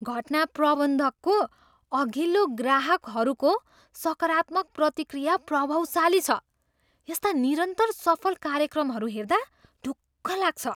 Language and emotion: Nepali, surprised